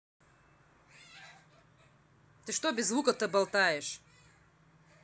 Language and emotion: Russian, angry